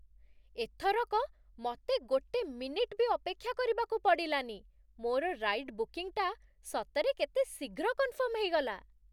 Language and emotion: Odia, surprised